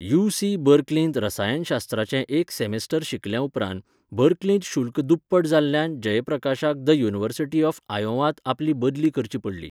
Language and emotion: Goan Konkani, neutral